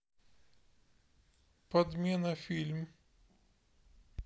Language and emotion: Russian, sad